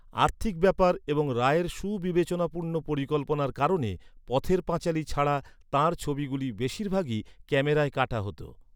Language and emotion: Bengali, neutral